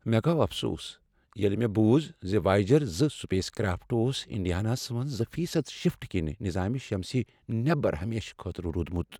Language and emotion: Kashmiri, sad